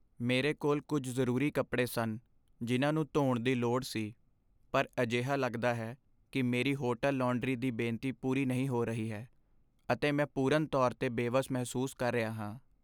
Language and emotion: Punjabi, sad